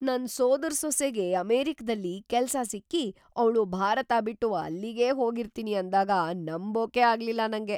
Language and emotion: Kannada, surprised